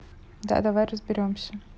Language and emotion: Russian, neutral